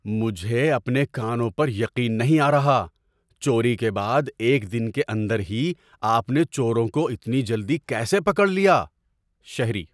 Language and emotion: Urdu, surprised